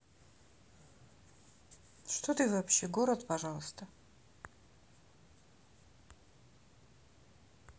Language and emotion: Russian, neutral